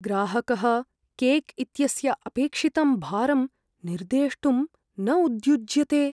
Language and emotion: Sanskrit, fearful